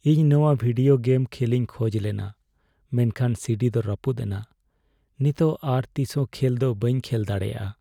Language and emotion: Santali, sad